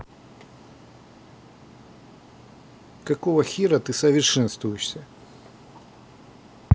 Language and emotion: Russian, angry